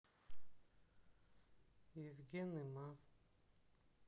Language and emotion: Russian, sad